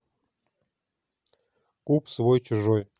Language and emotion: Russian, neutral